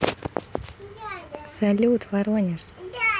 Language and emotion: Russian, positive